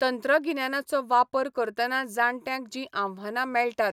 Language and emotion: Goan Konkani, neutral